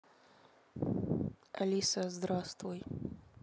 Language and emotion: Russian, neutral